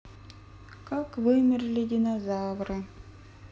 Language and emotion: Russian, sad